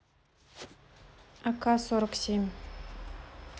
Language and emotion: Russian, neutral